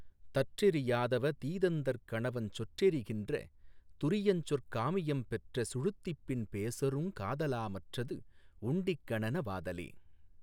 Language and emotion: Tamil, neutral